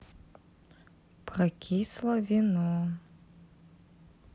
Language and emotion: Russian, neutral